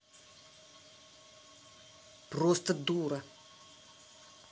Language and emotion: Russian, angry